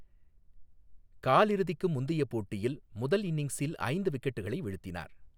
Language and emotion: Tamil, neutral